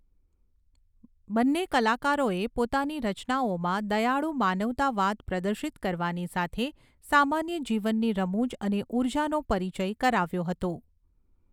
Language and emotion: Gujarati, neutral